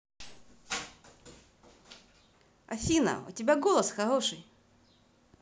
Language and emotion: Russian, positive